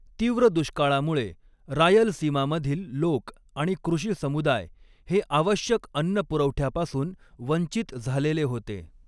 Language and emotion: Marathi, neutral